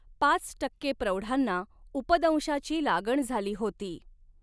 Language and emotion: Marathi, neutral